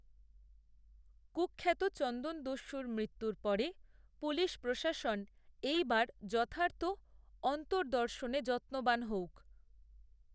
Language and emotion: Bengali, neutral